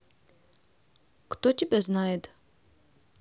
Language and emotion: Russian, neutral